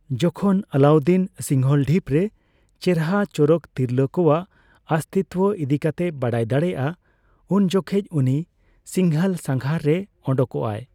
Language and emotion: Santali, neutral